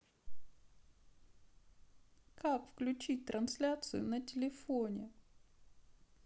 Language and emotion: Russian, sad